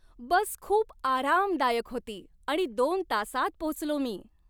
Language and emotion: Marathi, happy